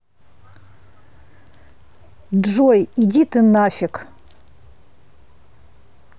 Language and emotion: Russian, angry